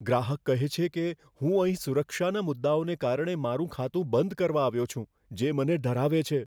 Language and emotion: Gujarati, fearful